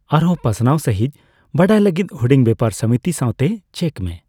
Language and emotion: Santali, neutral